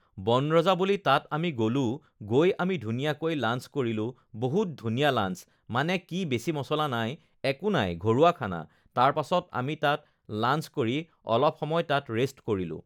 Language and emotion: Assamese, neutral